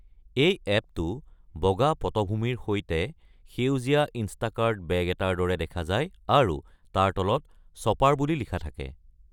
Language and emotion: Assamese, neutral